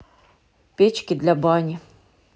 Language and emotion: Russian, neutral